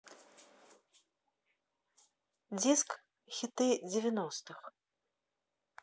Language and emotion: Russian, neutral